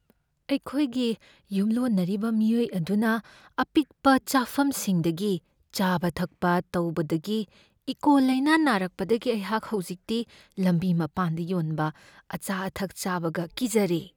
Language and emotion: Manipuri, fearful